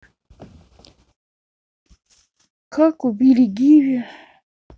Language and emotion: Russian, sad